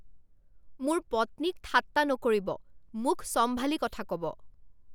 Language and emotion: Assamese, angry